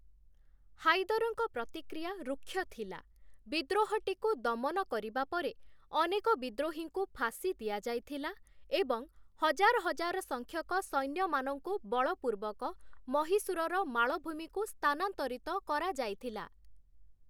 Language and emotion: Odia, neutral